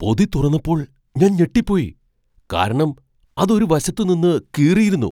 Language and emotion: Malayalam, surprised